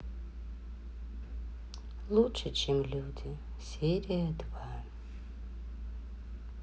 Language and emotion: Russian, sad